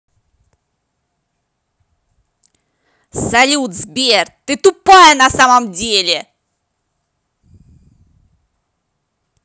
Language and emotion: Russian, angry